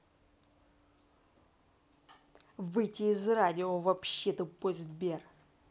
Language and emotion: Russian, angry